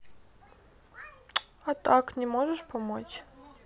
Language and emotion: Russian, sad